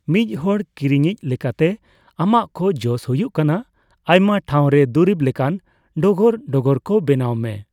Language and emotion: Santali, neutral